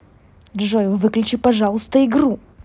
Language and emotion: Russian, angry